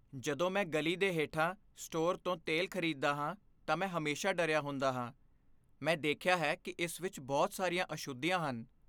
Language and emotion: Punjabi, fearful